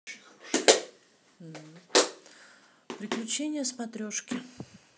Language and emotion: Russian, neutral